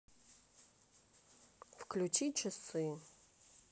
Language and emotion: Russian, neutral